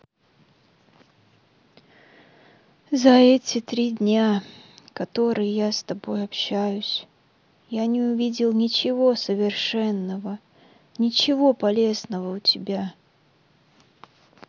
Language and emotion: Russian, sad